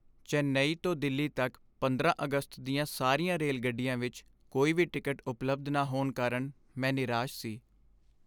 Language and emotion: Punjabi, sad